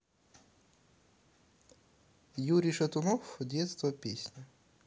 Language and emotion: Russian, neutral